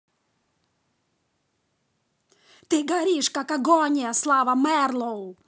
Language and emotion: Russian, angry